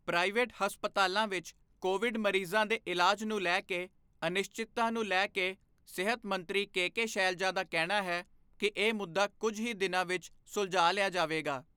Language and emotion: Punjabi, neutral